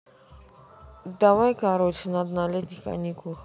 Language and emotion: Russian, neutral